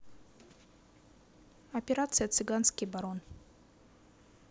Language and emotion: Russian, neutral